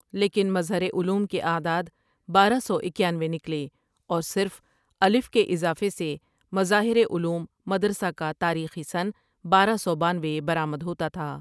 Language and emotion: Urdu, neutral